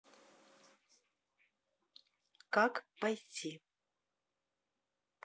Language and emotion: Russian, neutral